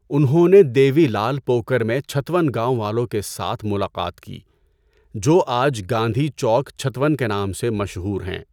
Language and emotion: Urdu, neutral